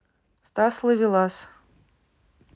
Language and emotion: Russian, neutral